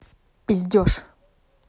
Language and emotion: Russian, angry